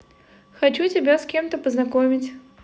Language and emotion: Russian, positive